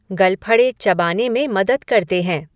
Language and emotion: Hindi, neutral